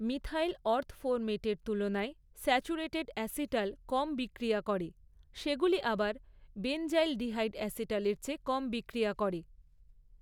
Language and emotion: Bengali, neutral